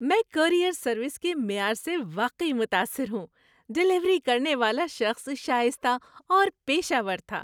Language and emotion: Urdu, happy